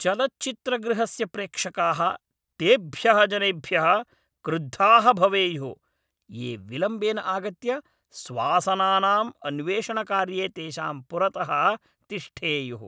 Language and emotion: Sanskrit, angry